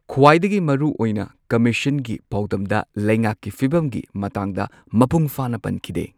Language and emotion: Manipuri, neutral